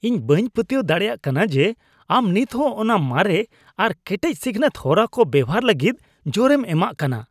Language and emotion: Santali, disgusted